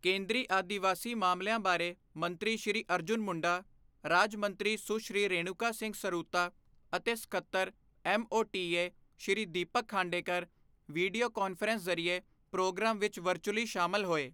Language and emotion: Punjabi, neutral